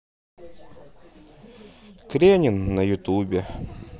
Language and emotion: Russian, neutral